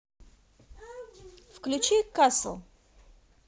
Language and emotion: Russian, positive